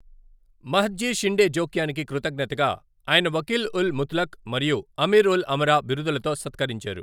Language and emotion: Telugu, neutral